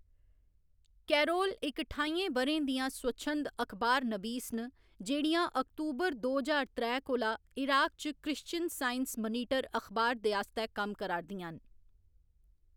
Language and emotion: Dogri, neutral